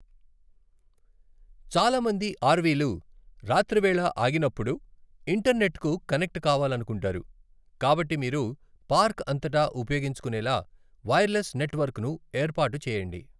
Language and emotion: Telugu, neutral